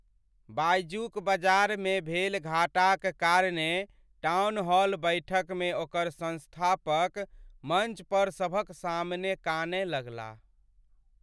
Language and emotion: Maithili, sad